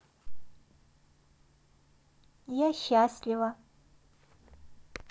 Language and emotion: Russian, neutral